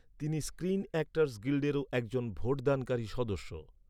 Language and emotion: Bengali, neutral